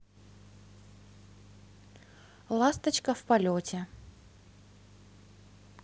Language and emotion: Russian, neutral